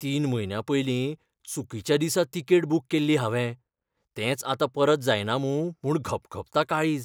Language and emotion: Goan Konkani, fearful